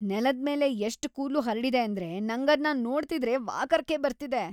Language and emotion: Kannada, disgusted